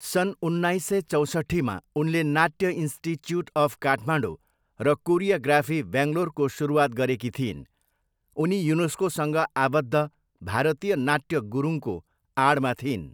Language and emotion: Nepali, neutral